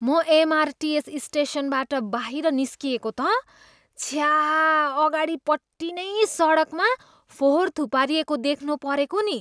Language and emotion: Nepali, disgusted